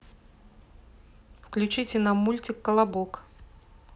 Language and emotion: Russian, neutral